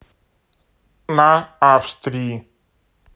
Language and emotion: Russian, neutral